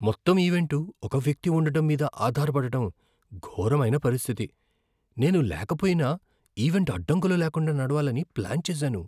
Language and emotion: Telugu, fearful